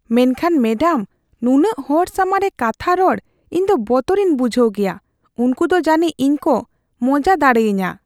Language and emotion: Santali, fearful